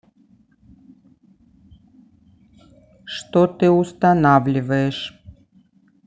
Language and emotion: Russian, neutral